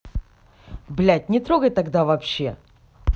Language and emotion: Russian, angry